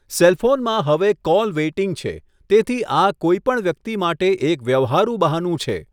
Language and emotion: Gujarati, neutral